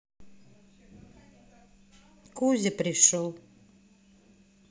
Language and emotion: Russian, neutral